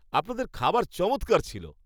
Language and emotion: Bengali, happy